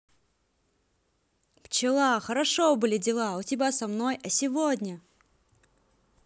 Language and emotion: Russian, positive